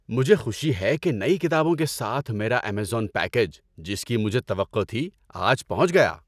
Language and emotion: Urdu, happy